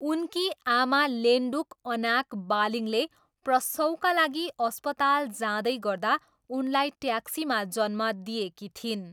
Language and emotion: Nepali, neutral